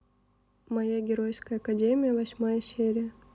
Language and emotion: Russian, neutral